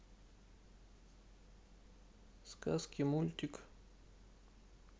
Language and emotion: Russian, sad